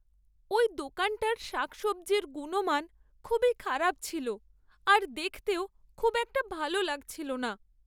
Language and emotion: Bengali, sad